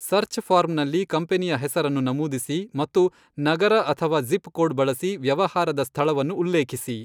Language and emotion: Kannada, neutral